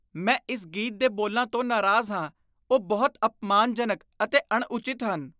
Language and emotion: Punjabi, disgusted